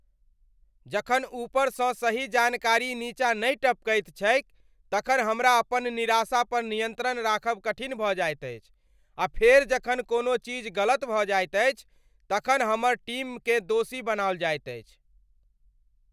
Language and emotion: Maithili, angry